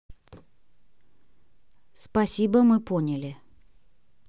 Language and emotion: Russian, neutral